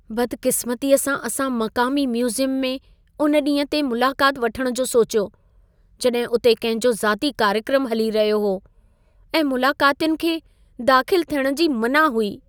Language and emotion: Sindhi, sad